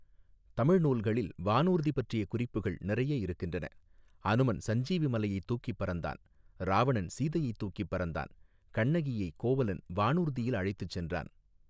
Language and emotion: Tamil, neutral